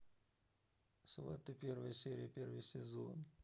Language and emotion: Russian, neutral